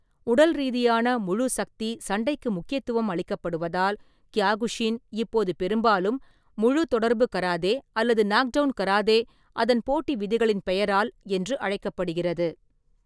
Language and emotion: Tamil, neutral